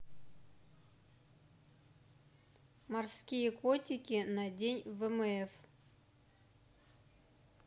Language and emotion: Russian, neutral